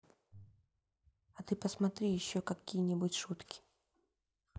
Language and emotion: Russian, neutral